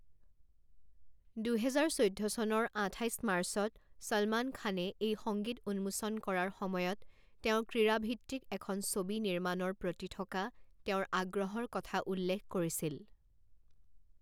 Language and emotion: Assamese, neutral